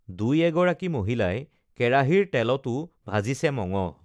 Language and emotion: Assamese, neutral